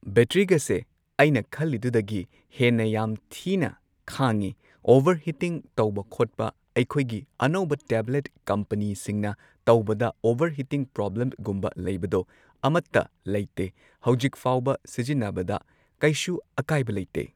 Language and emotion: Manipuri, neutral